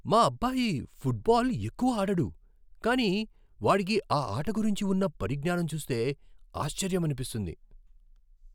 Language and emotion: Telugu, surprised